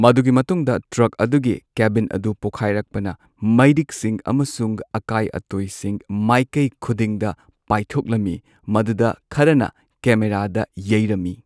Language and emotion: Manipuri, neutral